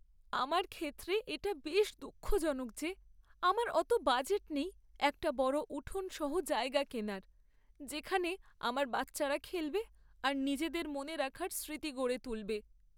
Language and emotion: Bengali, sad